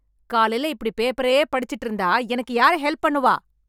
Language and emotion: Tamil, angry